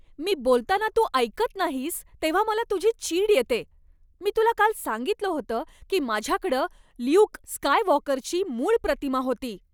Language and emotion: Marathi, angry